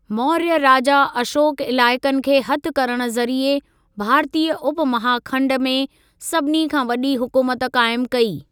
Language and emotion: Sindhi, neutral